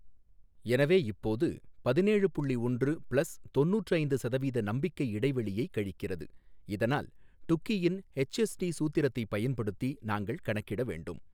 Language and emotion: Tamil, neutral